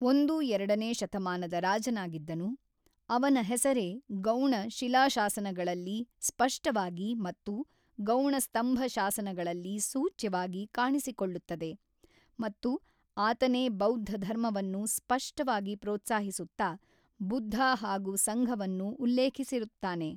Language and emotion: Kannada, neutral